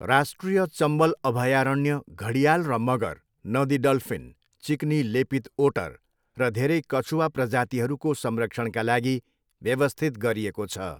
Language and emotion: Nepali, neutral